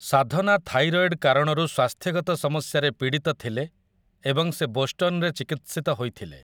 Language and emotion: Odia, neutral